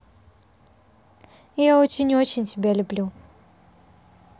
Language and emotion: Russian, positive